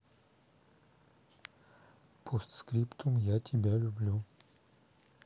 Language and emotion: Russian, neutral